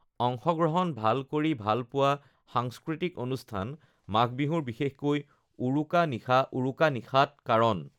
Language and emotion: Assamese, neutral